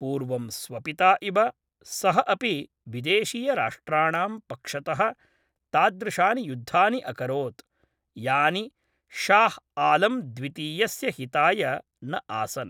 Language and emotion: Sanskrit, neutral